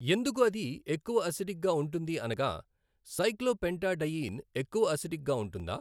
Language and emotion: Telugu, neutral